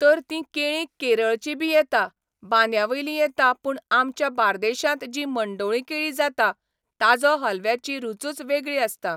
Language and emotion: Goan Konkani, neutral